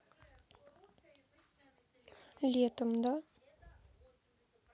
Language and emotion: Russian, sad